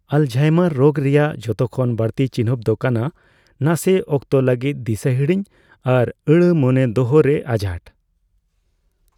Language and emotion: Santali, neutral